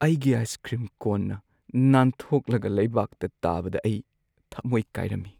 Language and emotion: Manipuri, sad